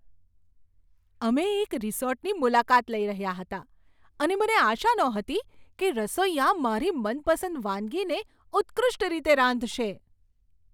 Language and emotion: Gujarati, surprised